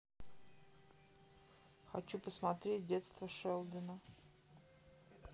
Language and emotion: Russian, neutral